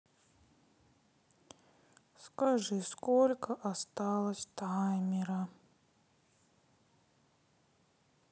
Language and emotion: Russian, sad